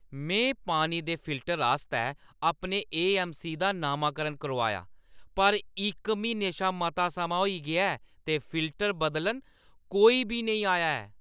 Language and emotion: Dogri, angry